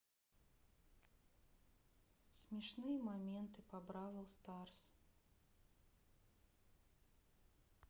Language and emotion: Russian, neutral